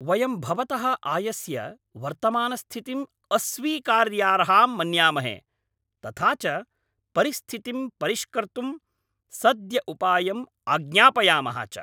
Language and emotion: Sanskrit, angry